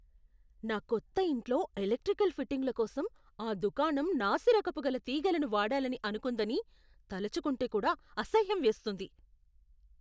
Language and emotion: Telugu, disgusted